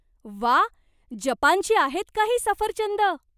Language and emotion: Marathi, surprised